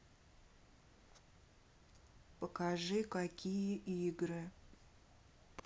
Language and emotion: Russian, neutral